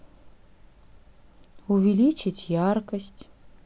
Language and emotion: Russian, neutral